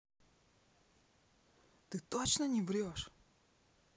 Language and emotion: Russian, neutral